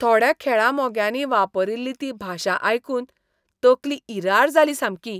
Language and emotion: Goan Konkani, disgusted